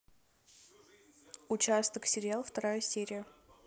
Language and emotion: Russian, neutral